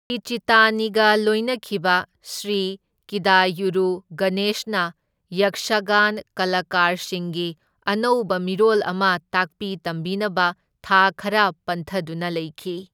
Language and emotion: Manipuri, neutral